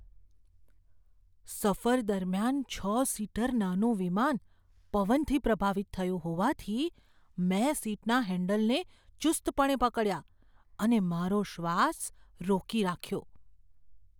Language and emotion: Gujarati, fearful